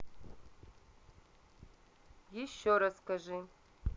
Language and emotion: Russian, neutral